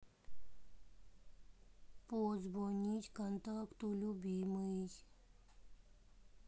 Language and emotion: Russian, sad